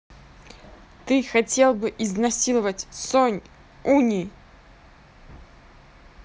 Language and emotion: Russian, angry